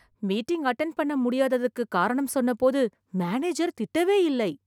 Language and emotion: Tamil, surprised